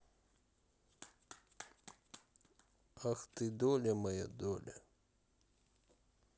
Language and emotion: Russian, sad